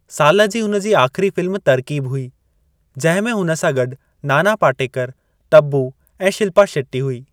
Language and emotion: Sindhi, neutral